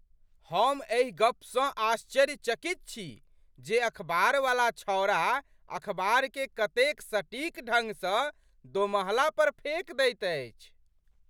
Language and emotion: Maithili, surprised